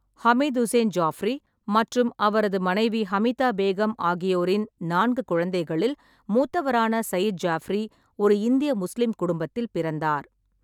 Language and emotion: Tamil, neutral